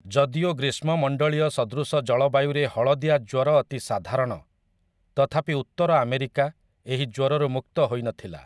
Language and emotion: Odia, neutral